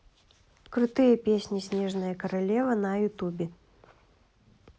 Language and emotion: Russian, neutral